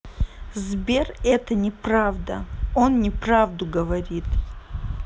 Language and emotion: Russian, angry